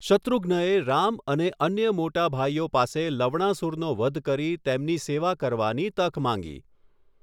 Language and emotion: Gujarati, neutral